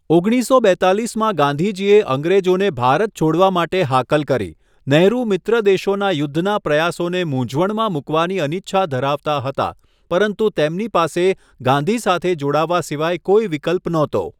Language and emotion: Gujarati, neutral